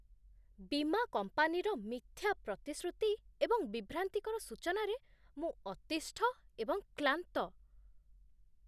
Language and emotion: Odia, disgusted